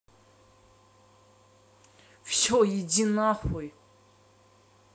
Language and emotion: Russian, angry